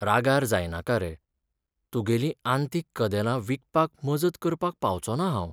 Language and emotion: Goan Konkani, sad